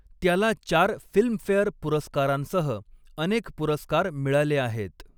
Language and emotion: Marathi, neutral